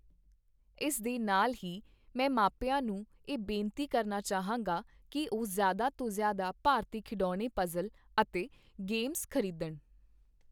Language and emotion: Punjabi, neutral